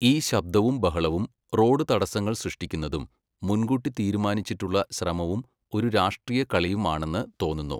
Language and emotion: Malayalam, neutral